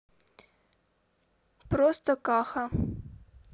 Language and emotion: Russian, neutral